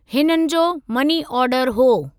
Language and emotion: Sindhi, neutral